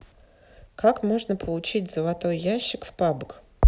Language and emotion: Russian, neutral